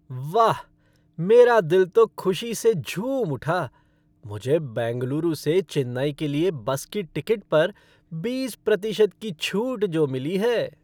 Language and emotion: Hindi, happy